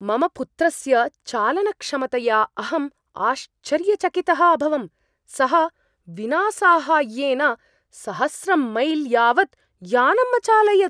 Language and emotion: Sanskrit, surprised